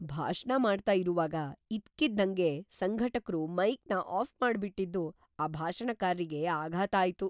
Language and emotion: Kannada, surprised